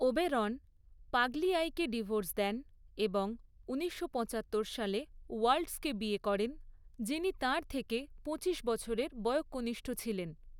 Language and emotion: Bengali, neutral